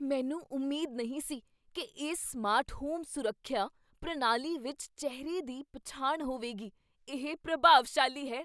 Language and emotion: Punjabi, surprised